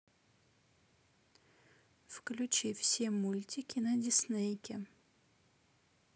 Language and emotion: Russian, neutral